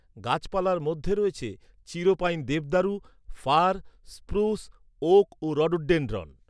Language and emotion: Bengali, neutral